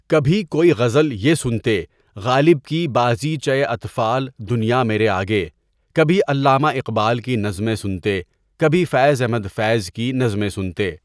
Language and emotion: Urdu, neutral